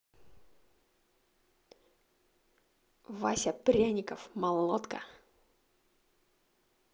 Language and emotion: Russian, positive